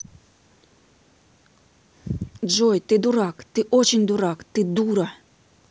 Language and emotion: Russian, angry